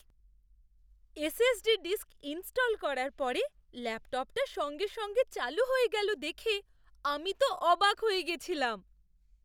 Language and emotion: Bengali, surprised